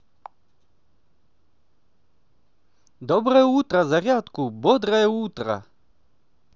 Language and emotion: Russian, positive